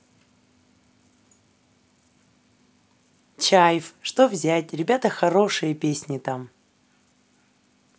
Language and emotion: Russian, positive